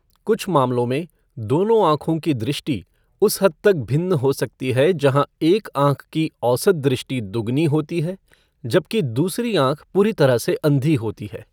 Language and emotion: Hindi, neutral